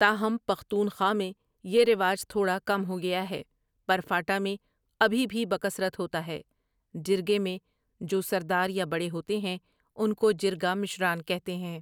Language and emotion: Urdu, neutral